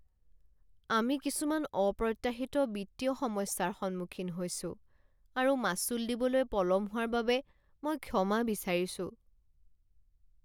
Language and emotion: Assamese, sad